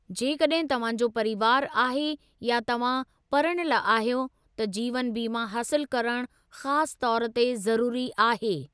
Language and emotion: Sindhi, neutral